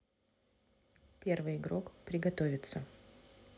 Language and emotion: Russian, neutral